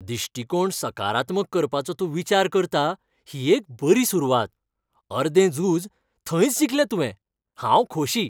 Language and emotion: Goan Konkani, happy